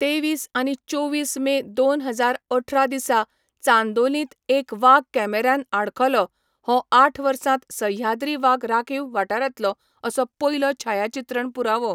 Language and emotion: Goan Konkani, neutral